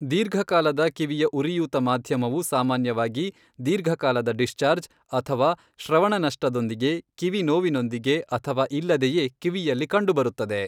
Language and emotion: Kannada, neutral